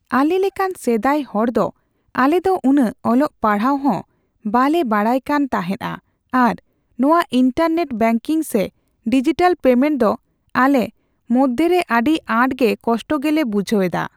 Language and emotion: Santali, neutral